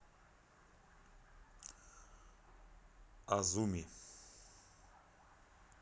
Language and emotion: Russian, neutral